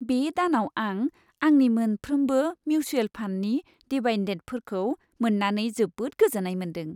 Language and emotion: Bodo, happy